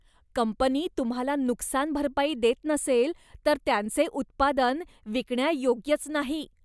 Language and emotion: Marathi, disgusted